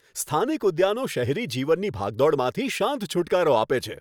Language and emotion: Gujarati, happy